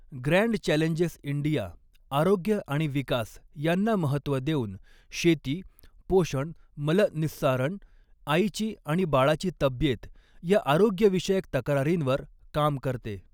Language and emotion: Marathi, neutral